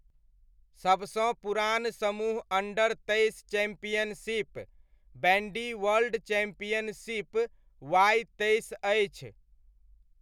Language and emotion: Maithili, neutral